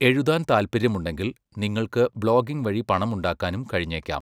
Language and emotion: Malayalam, neutral